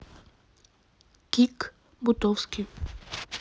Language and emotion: Russian, neutral